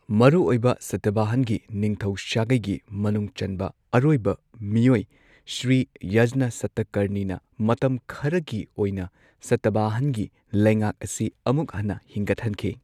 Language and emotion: Manipuri, neutral